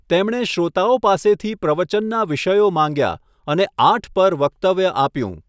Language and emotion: Gujarati, neutral